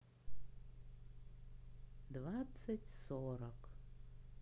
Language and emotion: Russian, neutral